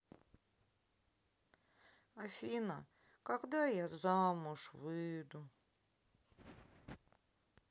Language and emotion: Russian, sad